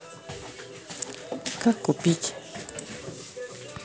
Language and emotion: Russian, neutral